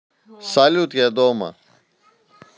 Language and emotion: Russian, neutral